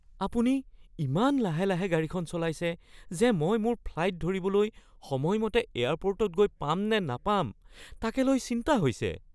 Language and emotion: Assamese, fearful